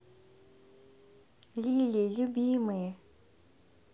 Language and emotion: Russian, positive